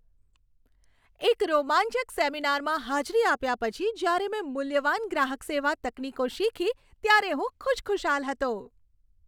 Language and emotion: Gujarati, happy